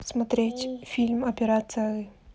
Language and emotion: Russian, neutral